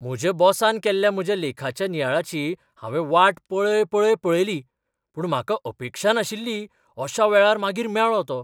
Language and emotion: Goan Konkani, surprised